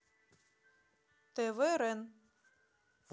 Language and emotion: Russian, neutral